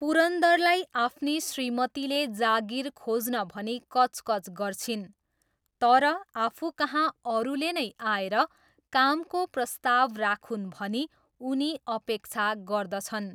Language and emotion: Nepali, neutral